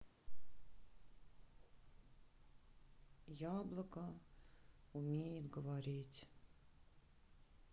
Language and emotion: Russian, sad